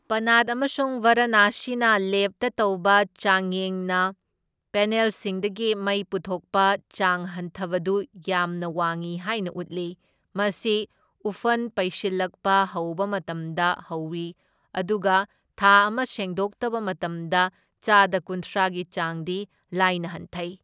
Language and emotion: Manipuri, neutral